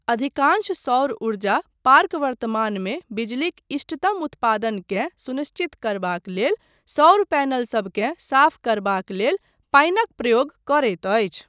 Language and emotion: Maithili, neutral